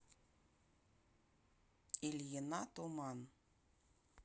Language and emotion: Russian, neutral